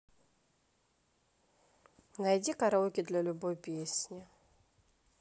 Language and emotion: Russian, neutral